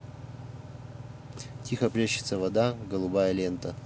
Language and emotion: Russian, neutral